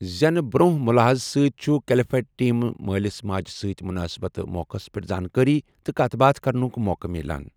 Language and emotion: Kashmiri, neutral